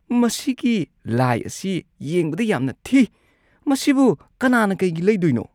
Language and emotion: Manipuri, disgusted